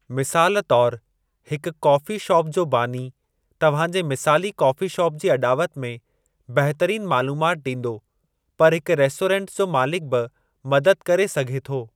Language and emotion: Sindhi, neutral